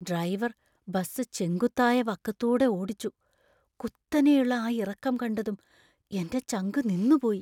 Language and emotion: Malayalam, fearful